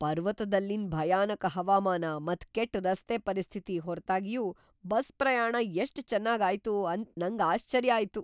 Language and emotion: Kannada, surprised